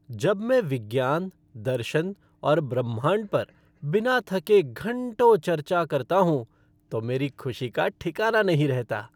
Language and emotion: Hindi, happy